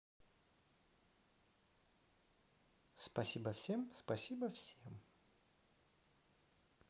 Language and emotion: Russian, positive